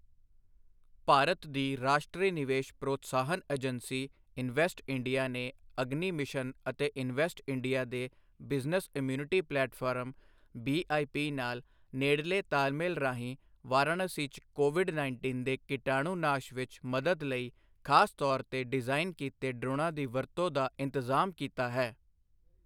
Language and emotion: Punjabi, neutral